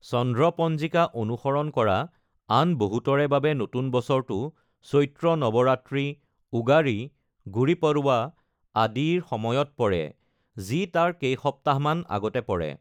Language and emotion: Assamese, neutral